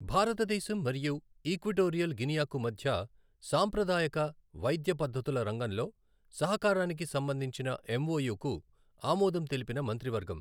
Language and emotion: Telugu, neutral